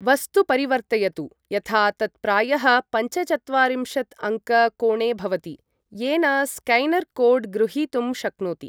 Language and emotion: Sanskrit, neutral